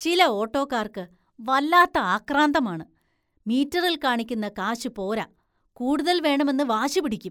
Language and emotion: Malayalam, disgusted